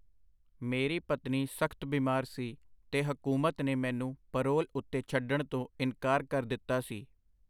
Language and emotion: Punjabi, neutral